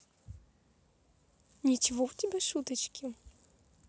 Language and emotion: Russian, positive